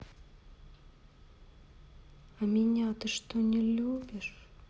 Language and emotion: Russian, neutral